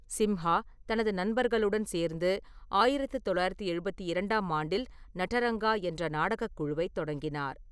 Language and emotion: Tamil, neutral